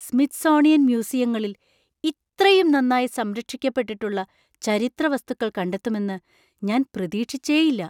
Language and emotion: Malayalam, surprised